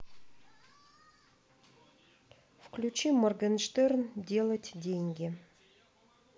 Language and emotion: Russian, neutral